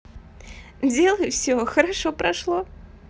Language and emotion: Russian, positive